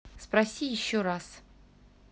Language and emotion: Russian, neutral